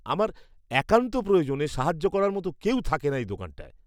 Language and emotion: Bengali, disgusted